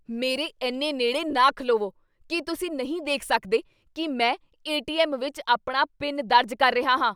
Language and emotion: Punjabi, angry